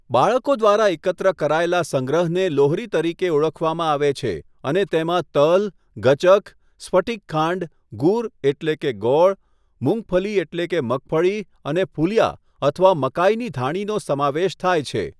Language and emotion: Gujarati, neutral